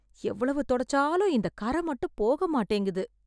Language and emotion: Tamil, sad